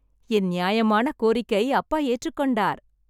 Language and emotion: Tamil, happy